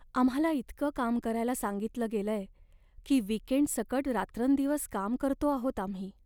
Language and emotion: Marathi, sad